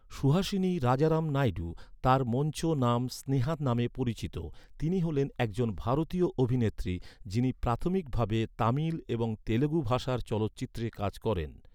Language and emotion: Bengali, neutral